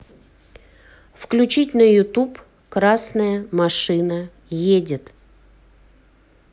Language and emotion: Russian, neutral